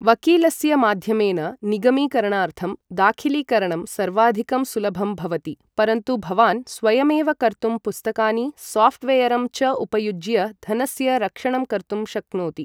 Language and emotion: Sanskrit, neutral